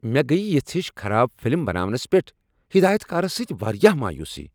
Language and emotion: Kashmiri, angry